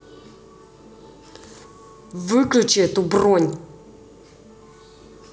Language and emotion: Russian, angry